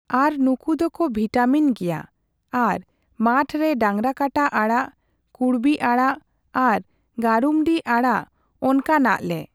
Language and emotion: Santali, neutral